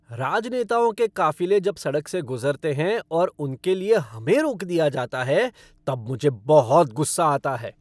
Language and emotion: Hindi, angry